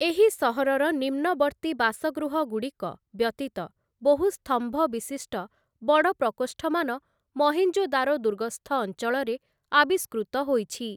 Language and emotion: Odia, neutral